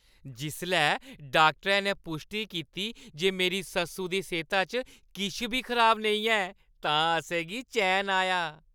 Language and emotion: Dogri, happy